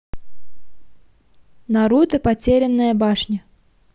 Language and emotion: Russian, neutral